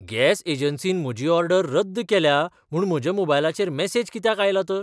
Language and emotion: Goan Konkani, surprised